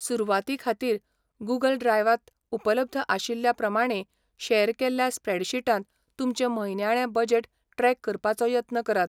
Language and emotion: Goan Konkani, neutral